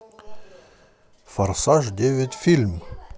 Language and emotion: Russian, positive